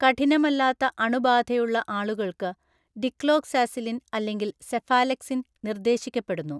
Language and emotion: Malayalam, neutral